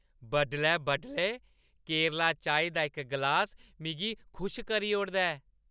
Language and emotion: Dogri, happy